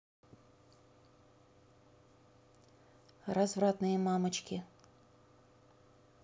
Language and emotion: Russian, neutral